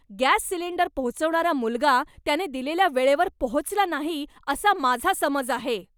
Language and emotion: Marathi, angry